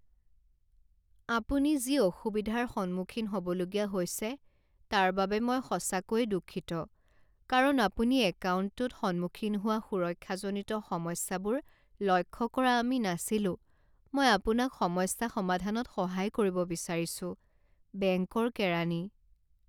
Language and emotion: Assamese, sad